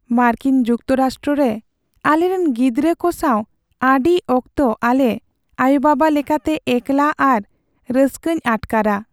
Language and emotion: Santali, sad